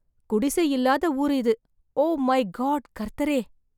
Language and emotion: Tamil, surprised